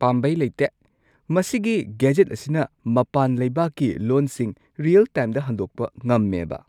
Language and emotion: Manipuri, surprised